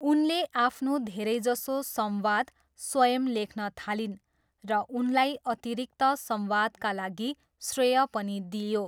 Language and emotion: Nepali, neutral